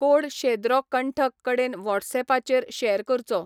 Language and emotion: Goan Konkani, neutral